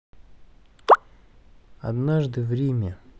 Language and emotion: Russian, neutral